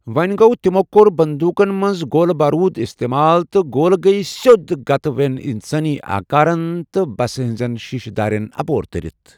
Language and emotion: Kashmiri, neutral